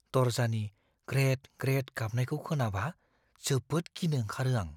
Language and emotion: Bodo, fearful